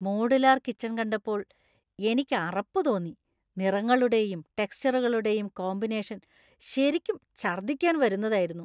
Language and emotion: Malayalam, disgusted